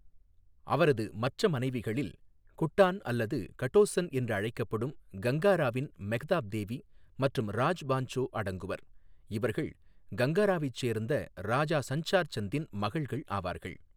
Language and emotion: Tamil, neutral